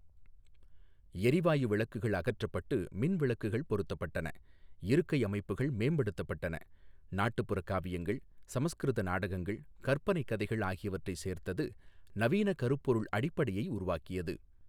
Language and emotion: Tamil, neutral